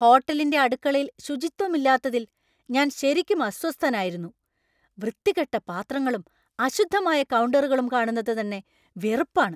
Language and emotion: Malayalam, angry